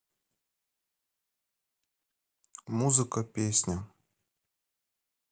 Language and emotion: Russian, neutral